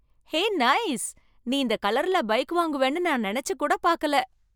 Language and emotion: Tamil, surprised